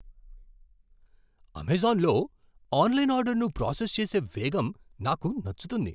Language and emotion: Telugu, surprised